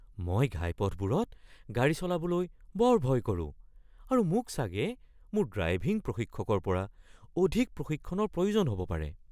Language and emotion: Assamese, fearful